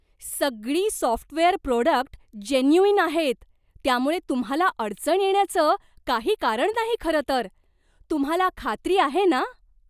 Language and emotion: Marathi, surprised